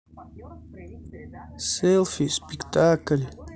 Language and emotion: Russian, neutral